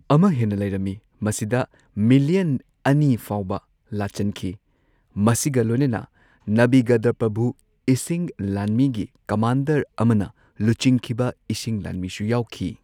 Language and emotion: Manipuri, neutral